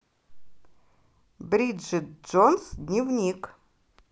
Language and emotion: Russian, positive